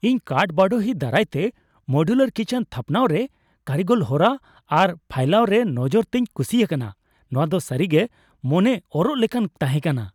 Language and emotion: Santali, happy